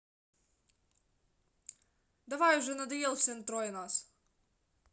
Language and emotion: Russian, angry